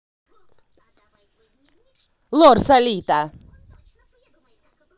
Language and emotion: Russian, angry